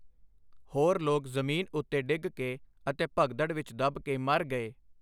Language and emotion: Punjabi, neutral